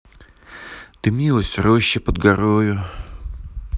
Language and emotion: Russian, neutral